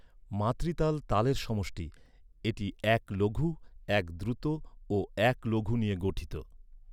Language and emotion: Bengali, neutral